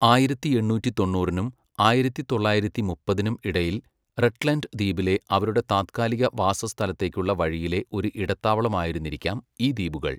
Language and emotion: Malayalam, neutral